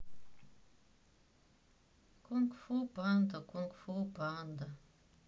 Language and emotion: Russian, sad